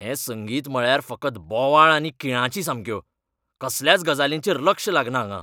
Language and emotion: Goan Konkani, angry